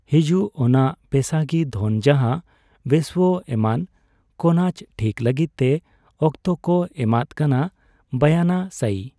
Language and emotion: Santali, neutral